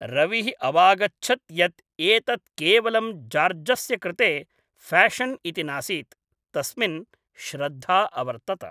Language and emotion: Sanskrit, neutral